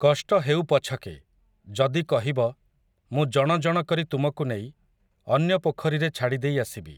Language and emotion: Odia, neutral